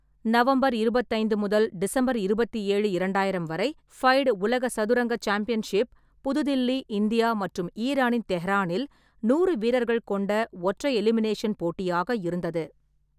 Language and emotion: Tamil, neutral